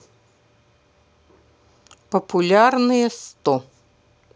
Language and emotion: Russian, neutral